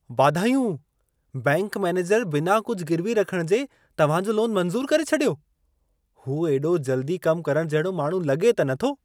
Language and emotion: Sindhi, surprised